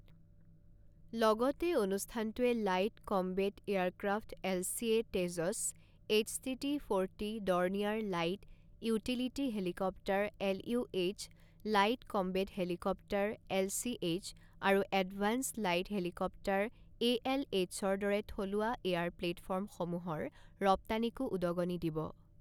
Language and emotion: Assamese, neutral